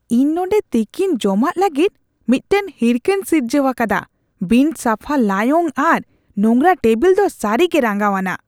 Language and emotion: Santali, disgusted